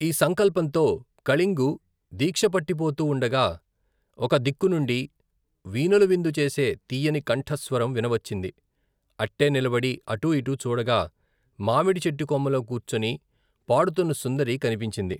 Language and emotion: Telugu, neutral